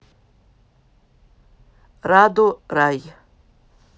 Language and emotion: Russian, neutral